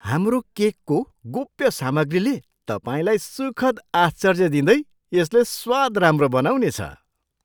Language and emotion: Nepali, surprised